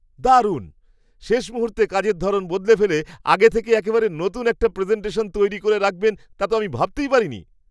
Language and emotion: Bengali, surprised